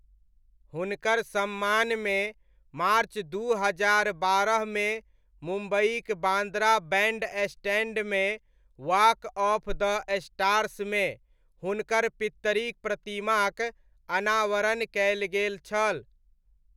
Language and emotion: Maithili, neutral